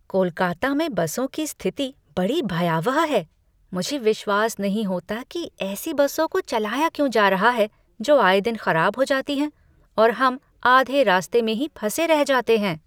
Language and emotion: Hindi, disgusted